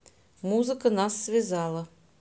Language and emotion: Russian, neutral